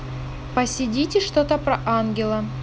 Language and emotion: Russian, neutral